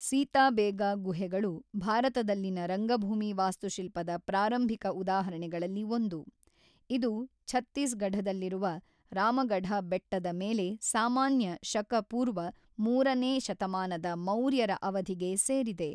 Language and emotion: Kannada, neutral